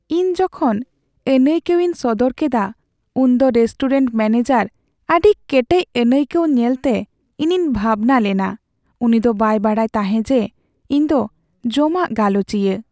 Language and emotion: Santali, sad